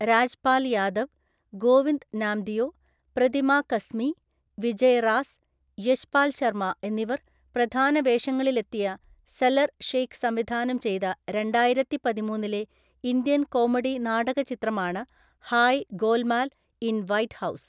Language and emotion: Malayalam, neutral